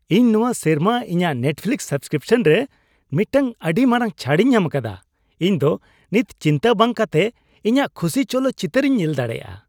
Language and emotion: Santali, happy